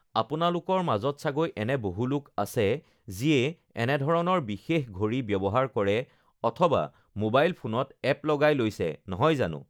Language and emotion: Assamese, neutral